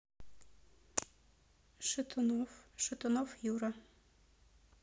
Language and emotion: Russian, neutral